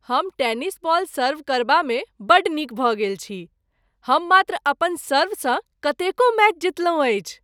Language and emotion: Maithili, happy